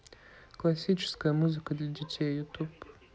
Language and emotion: Russian, neutral